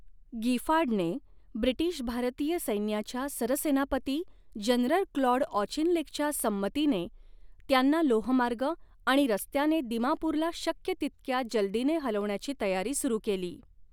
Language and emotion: Marathi, neutral